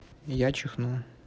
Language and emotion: Russian, neutral